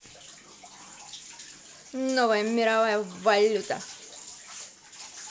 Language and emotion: Russian, positive